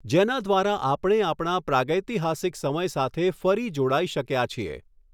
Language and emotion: Gujarati, neutral